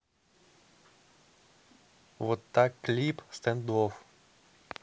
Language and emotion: Russian, neutral